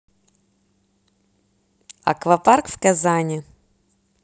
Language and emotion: Russian, neutral